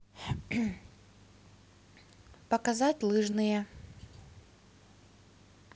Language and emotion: Russian, neutral